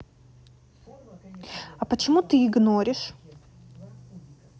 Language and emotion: Russian, neutral